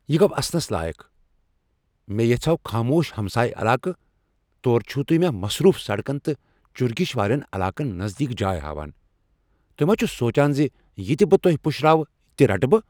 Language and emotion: Kashmiri, angry